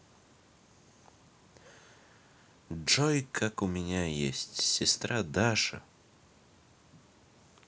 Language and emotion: Russian, neutral